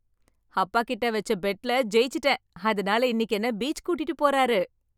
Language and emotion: Tamil, happy